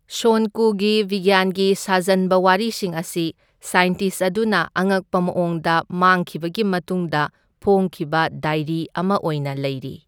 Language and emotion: Manipuri, neutral